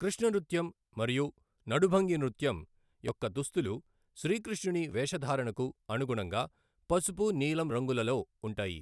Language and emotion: Telugu, neutral